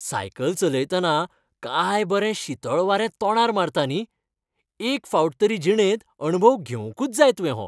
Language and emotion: Goan Konkani, happy